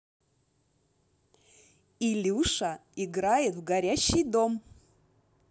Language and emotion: Russian, positive